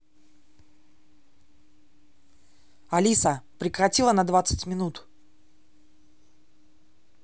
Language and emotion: Russian, angry